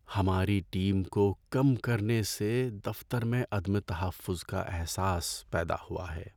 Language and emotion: Urdu, sad